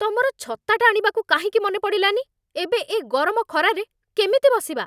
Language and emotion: Odia, angry